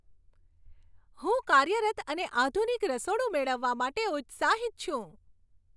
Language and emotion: Gujarati, happy